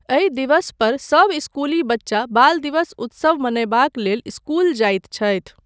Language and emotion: Maithili, neutral